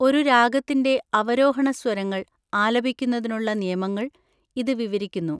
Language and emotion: Malayalam, neutral